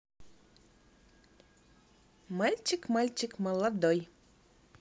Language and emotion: Russian, positive